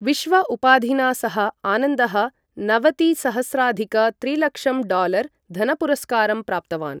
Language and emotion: Sanskrit, neutral